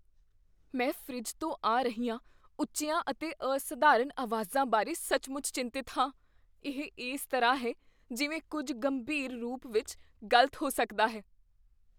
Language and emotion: Punjabi, fearful